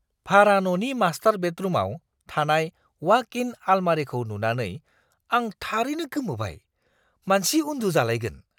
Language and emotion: Bodo, surprised